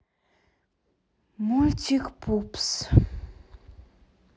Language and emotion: Russian, sad